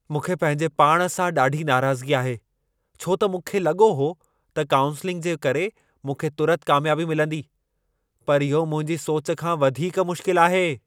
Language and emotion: Sindhi, angry